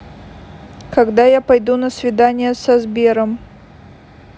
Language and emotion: Russian, neutral